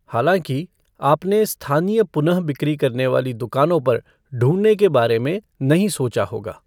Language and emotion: Hindi, neutral